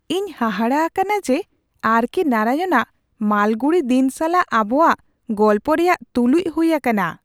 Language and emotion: Santali, surprised